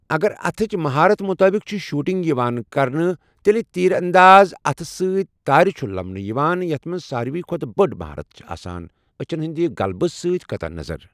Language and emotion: Kashmiri, neutral